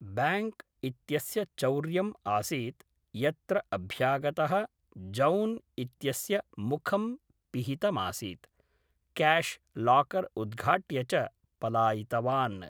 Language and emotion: Sanskrit, neutral